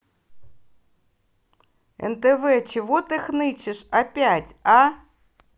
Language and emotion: Russian, angry